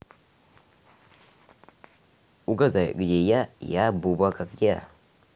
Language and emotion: Russian, neutral